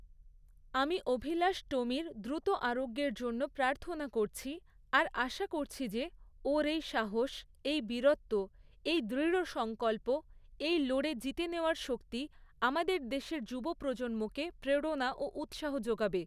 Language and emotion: Bengali, neutral